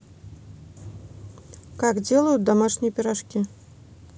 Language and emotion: Russian, neutral